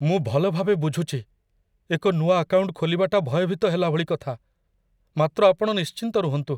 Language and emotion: Odia, fearful